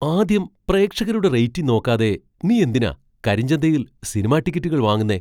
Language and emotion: Malayalam, surprised